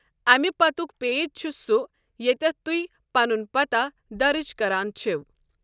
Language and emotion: Kashmiri, neutral